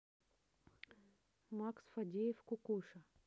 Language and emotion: Russian, neutral